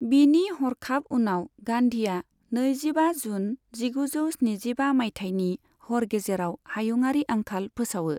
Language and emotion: Bodo, neutral